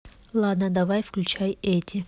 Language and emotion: Russian, neutral